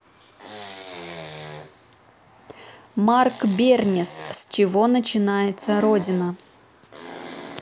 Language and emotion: Russian, neutral